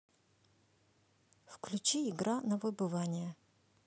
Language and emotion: Russian, neutral